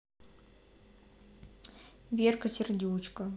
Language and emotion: Russian, neutral